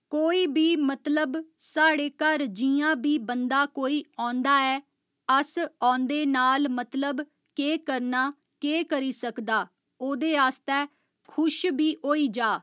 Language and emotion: Dogri, neutral